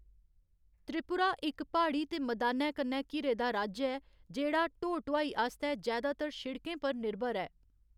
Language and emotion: Dogri, neutral